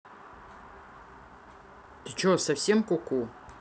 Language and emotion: Russian, angry